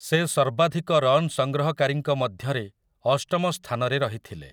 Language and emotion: Odia, neutral